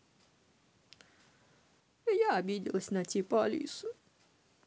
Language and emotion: Russian, sad